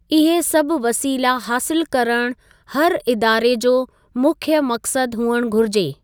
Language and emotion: Sindhi, neutral